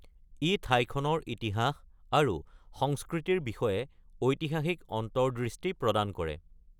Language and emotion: Assamese, neutral